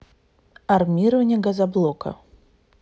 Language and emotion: Russian, neutral